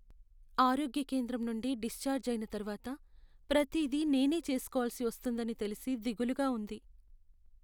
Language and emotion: Telugu, sad